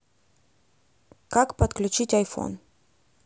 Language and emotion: Russian, neutral